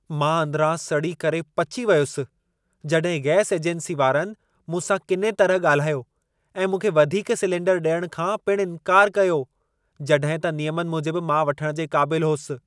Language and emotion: Sindhi, angry